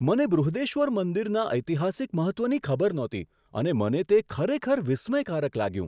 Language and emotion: Gujarati, surprised